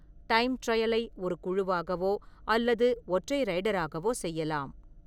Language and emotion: Tamil, neutral